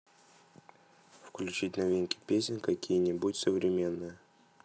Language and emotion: Russian, neutral